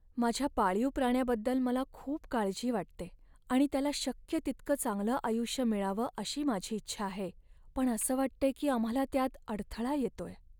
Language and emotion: Marathi, sad